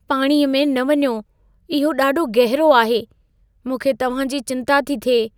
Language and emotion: Sindhi, fearful